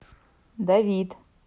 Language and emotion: Russian, neutral